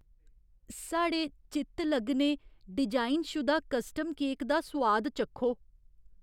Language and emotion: Dogri, fearful